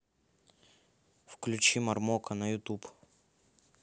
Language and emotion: Russian, neutral